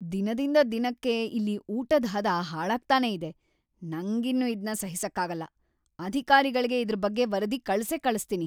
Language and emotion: Kannada, angry